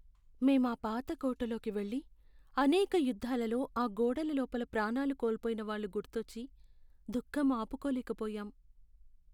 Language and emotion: Telugu, sad